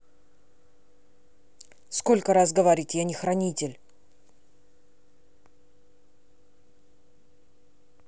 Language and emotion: Russian, angry